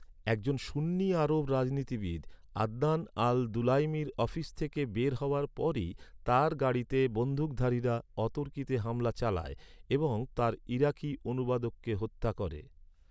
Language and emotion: Bengali, neutral